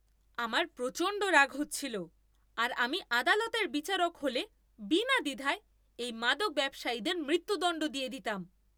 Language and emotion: Bengali, angry